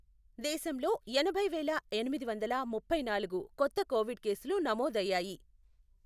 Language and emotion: Telugu, neutral